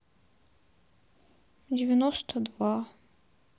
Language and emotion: Russian, sad